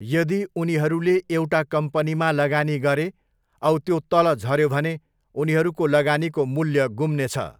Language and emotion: Nepali, neutral